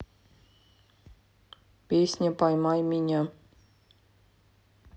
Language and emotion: Russian, neutral